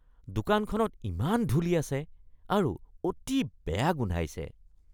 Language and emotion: Assamese, disgusted